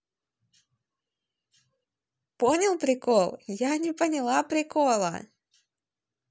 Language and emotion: Russian, positive